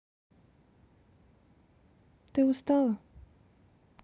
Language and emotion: Russian, neutral